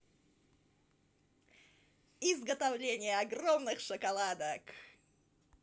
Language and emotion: Russian, positive